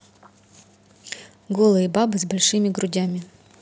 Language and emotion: Russian, neutral